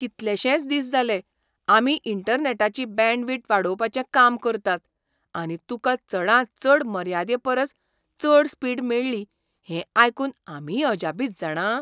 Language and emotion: Goan Konkani, surprised